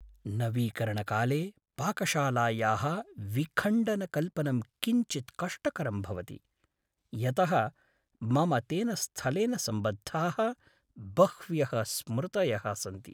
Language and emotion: Sanskrit, sad